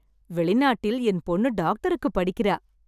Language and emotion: Tamil, happy